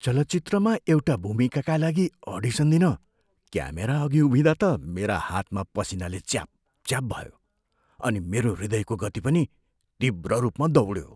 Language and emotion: Nepali, fearful